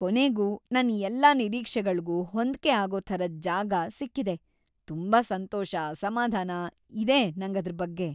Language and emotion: Kannada, happy